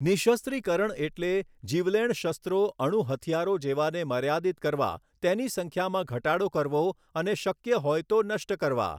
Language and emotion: Gujarati, neutral